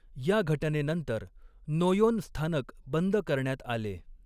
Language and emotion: Marathi, neutral